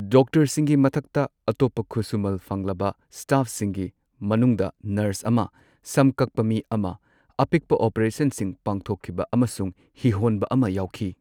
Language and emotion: Manipuri, neutral